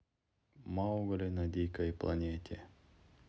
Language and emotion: Russian, neutral